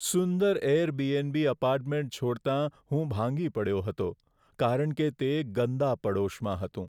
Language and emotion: Gujarati, sad